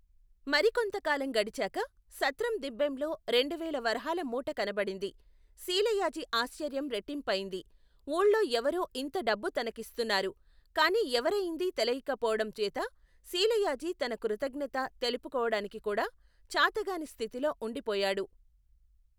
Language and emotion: Telugu, neutral